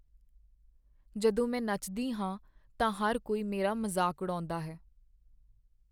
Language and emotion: Punjabi, sad